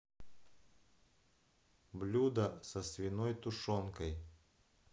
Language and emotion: Russian, neutral